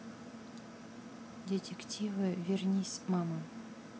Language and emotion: Russian, neutral